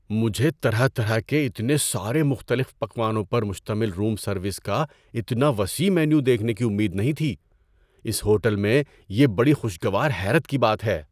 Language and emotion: Urdu, surprised